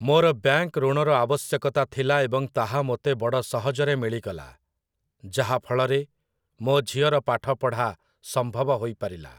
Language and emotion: Odia, neutral